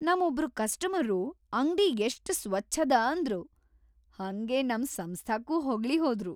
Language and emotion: Kannada, happy